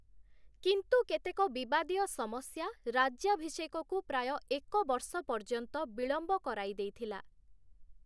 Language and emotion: Odia, neutral